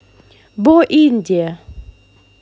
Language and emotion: Russian, positive